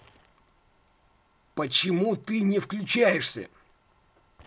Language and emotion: Russian, angry